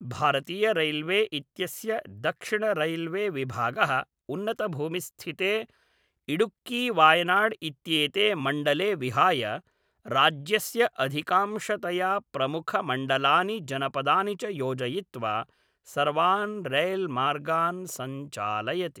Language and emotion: Sanskrit, neutral